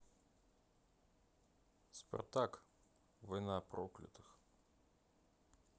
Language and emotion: Russian, neutral